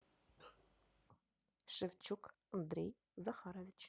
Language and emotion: Russian, neutral